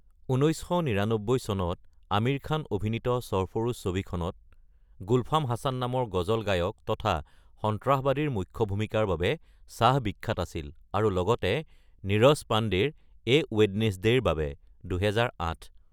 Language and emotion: Assamese, neutral